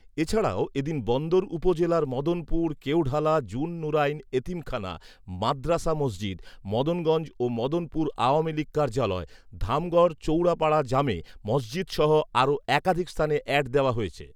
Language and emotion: Bengali, neutral